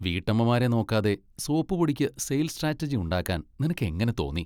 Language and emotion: Malayalam, disgusted